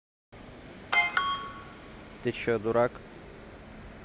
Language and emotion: Russian, neutral